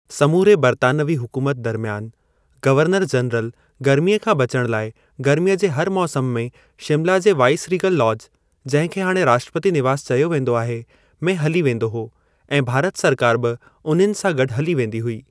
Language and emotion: Sindhi, neutral